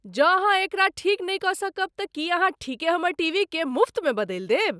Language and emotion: Maithili, surprised